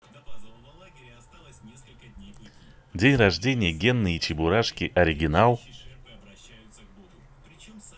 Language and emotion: Russian, positive